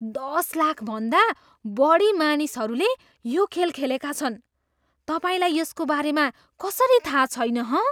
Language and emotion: Nepali, surprised